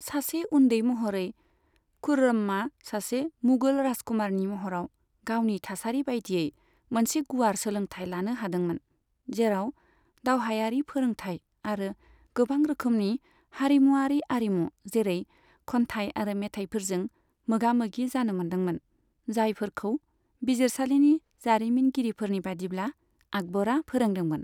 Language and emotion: Bodo, neutral